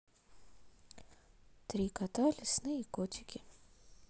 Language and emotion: Russian, neutral